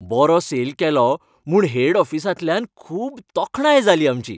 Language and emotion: Goan Konkani, happy